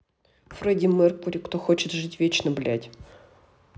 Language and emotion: Russian, angry